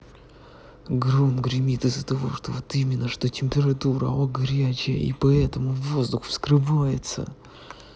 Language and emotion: Russian, angry